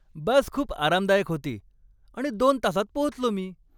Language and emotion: Marathi, happy